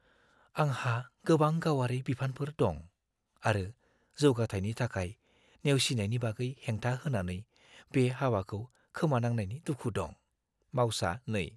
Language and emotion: Bodo, fearful